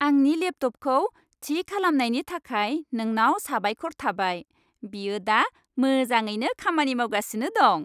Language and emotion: Bodo, happy